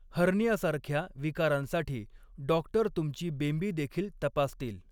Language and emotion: Marathi, neutral